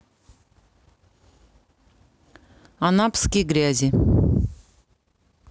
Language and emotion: Russian, neutral